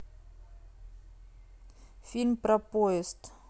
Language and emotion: Russian, neutral